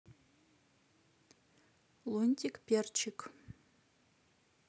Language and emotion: Russian, neutral